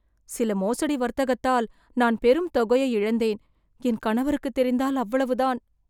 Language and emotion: Tamil, fearful